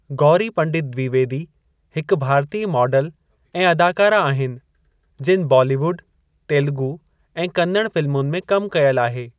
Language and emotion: Sindhi, neutral